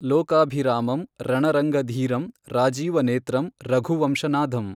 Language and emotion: Kannada, neutral